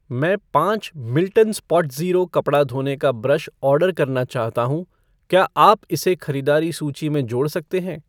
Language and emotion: Hindi, neutral